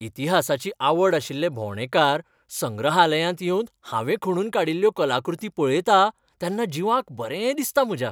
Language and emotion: Goan Konkani, happy